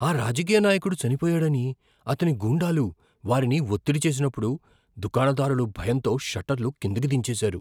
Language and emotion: Telugu, fearful